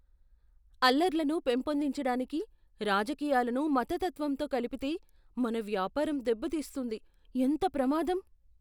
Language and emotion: Telugu, fearful